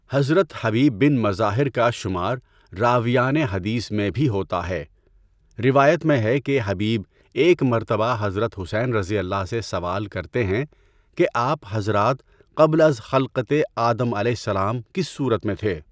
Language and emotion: Urdu, neutral